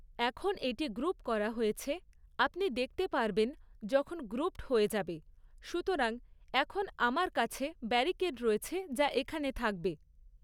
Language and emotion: Bengali, neutral